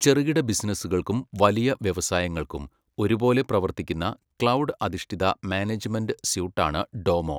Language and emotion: Malayalam, neutral